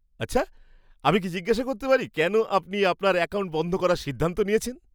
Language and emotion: Bengali, surprised